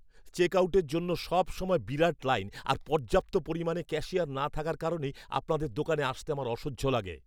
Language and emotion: Bengali, angry